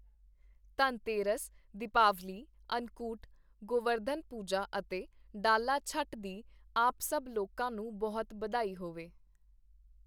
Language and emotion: Punjabi, neutral